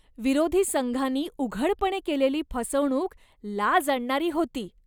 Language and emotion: Marathi, disgusted